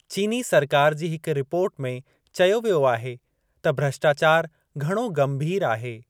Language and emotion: Sindhi, neutral